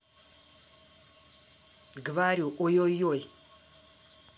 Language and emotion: Russian, angry